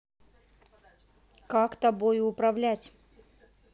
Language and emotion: Russian, angry